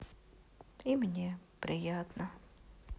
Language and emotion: Russian, sad